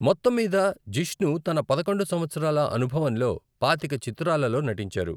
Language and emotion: Telugu, neutral